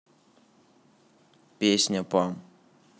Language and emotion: Russian, neutral